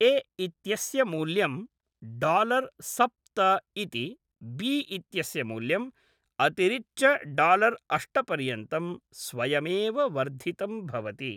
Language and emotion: Sanskrit, neutral